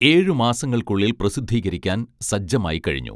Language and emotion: Malayalam, neutral